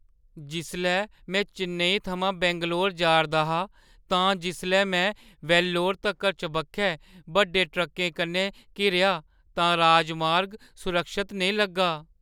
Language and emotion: Dogri, fearful